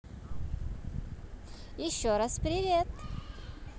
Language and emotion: Russian, positive